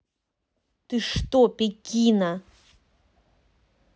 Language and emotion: Russian, angry